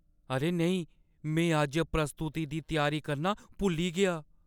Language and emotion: Dogri, fearful